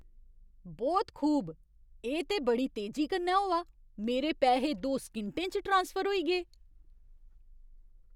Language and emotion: Dogri, surprised